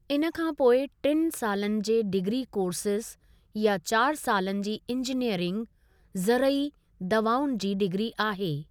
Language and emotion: Sindhi, neutral